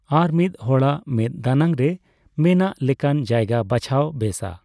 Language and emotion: Santali, neutral